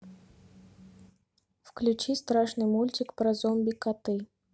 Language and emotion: Russian, neutral